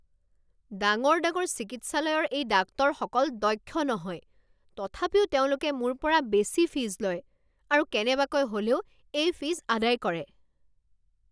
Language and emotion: Assamese, angry